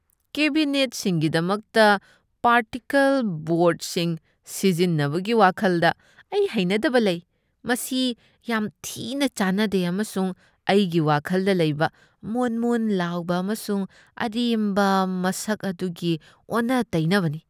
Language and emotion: Manipuri, disgusted